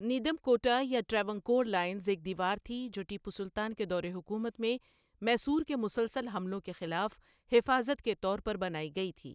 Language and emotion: Urdu, neutral